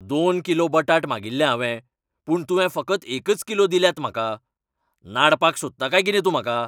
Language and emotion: Goan Konkani, angry